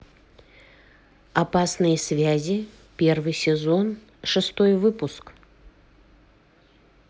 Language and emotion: Russian, neutral